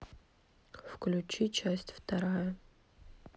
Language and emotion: Russian, sad